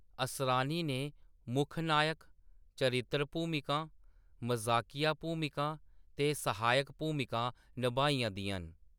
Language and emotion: Dogri, neutral